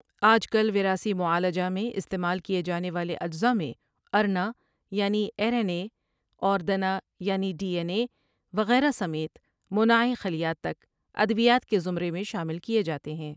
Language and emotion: Urdu, neutral